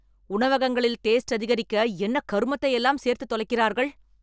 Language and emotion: Tamil, angry